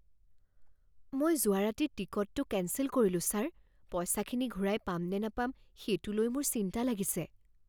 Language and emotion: Assamese, fearful